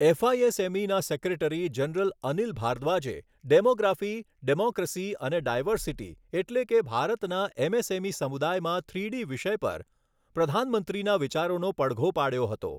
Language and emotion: Gujarati, neutral